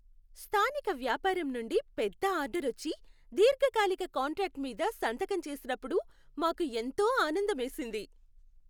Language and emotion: Telugu, happy